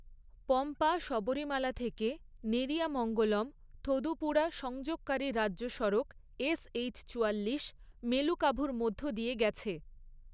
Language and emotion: Bengali, neutral